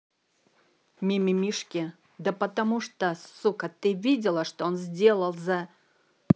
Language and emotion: Russian, angry